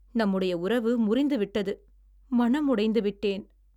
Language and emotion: Tamil, sad